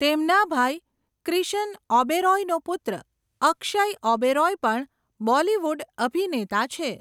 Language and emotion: Gujarati, neutral